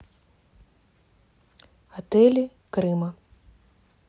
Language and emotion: Russian, neutral